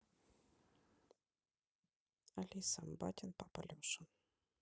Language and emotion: Russian, neutral